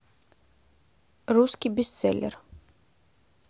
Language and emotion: Russian, neutral